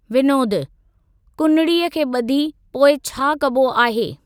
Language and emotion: Sindhi, neutral